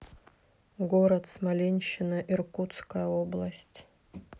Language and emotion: Russian, neutral